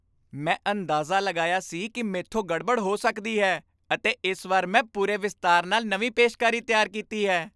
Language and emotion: Punjabi, happy